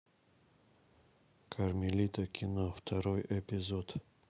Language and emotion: Russian, neutral